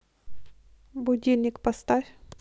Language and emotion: Russian, neutral